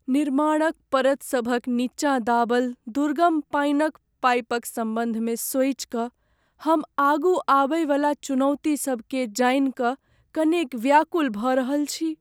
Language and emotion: Maithili, sad